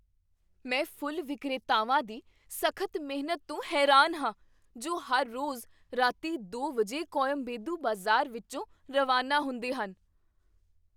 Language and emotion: Punjabi, surprised